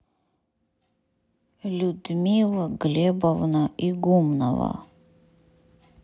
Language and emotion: Russian, neutral